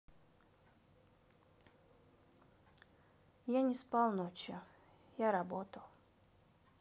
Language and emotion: Russian, sad